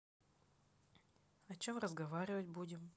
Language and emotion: Russian, neutral